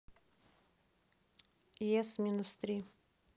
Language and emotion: Russian, neutral